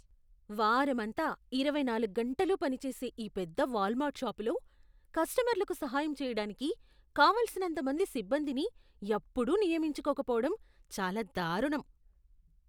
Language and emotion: Telugu, disgusted